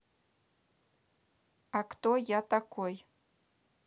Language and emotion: Russian, neutral